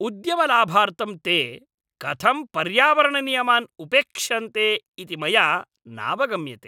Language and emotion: Sanskrit, angry